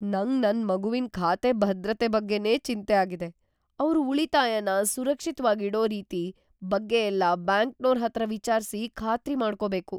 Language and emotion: Kannada, fearful